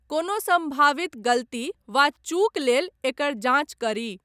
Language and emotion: Maithili, neutral